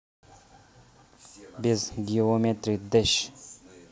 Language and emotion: Russian, neutral